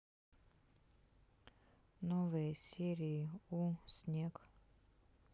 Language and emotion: Russian, sad